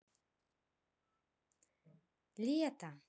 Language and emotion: Russian, neutral